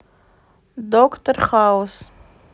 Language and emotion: Russian, neutral